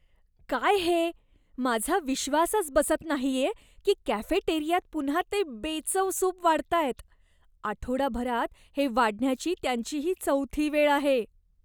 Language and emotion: Marathi, disgusted